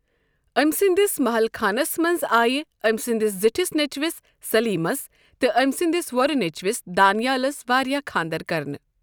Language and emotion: Kashmiri, neutral